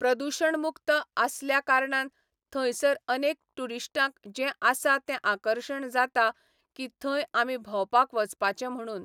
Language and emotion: Goan Konkani, neutral